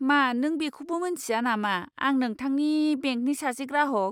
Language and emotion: Bodo, disgusted